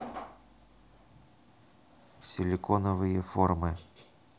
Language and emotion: Russian, neutral